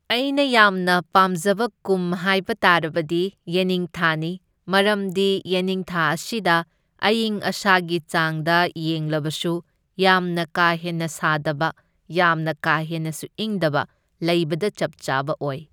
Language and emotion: Manipuri, neutral